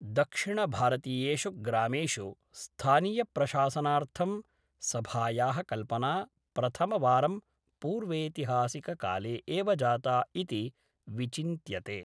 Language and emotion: Sanskrit, neutral